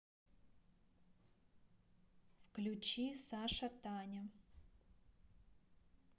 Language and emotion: Russian, neutral